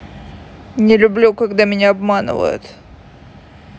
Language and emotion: Russian, sad